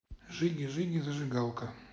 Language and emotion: Russian, neutral